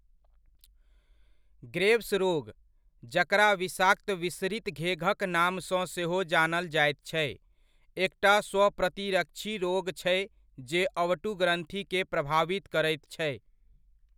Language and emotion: Maithili, neutral